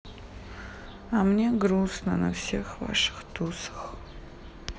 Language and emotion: Russian, sad